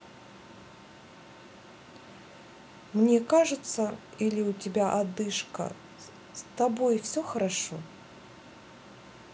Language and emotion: Russian, neutral